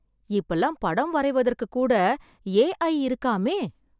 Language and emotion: Tamil, surprised